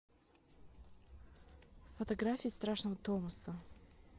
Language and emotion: Russian, neutral